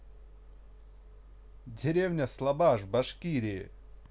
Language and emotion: Russian, neutral